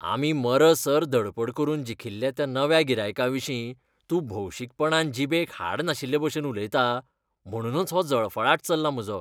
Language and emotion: Goan Konkani, disgusted